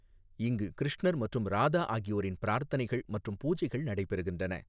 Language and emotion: Tamil, neutral